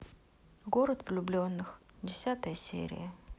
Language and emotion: Russian, neutral